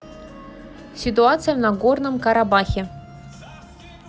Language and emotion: Russian, neutral